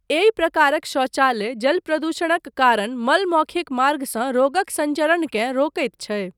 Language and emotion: Maithili, neutral